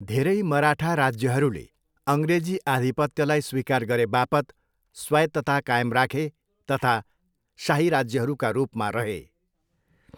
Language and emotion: Nepali, neutral